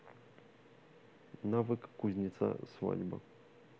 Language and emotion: Russian, neutral